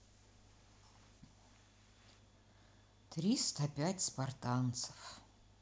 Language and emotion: Russian, sad